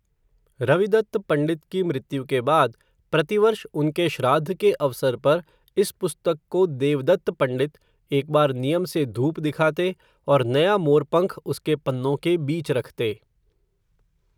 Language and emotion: Hindi, neutral